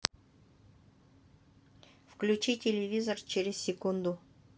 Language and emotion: Russian, neutral